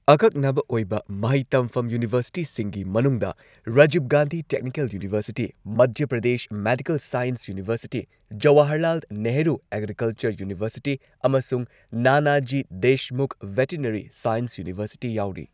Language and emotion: Manipuri, neutral